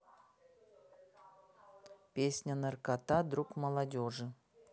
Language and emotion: Russian, neutral